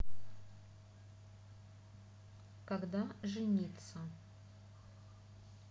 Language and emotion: Russian, neutral